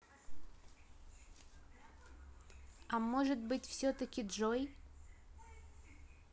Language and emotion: Russian, neutral